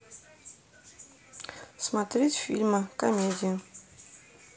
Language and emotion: Russian, neutral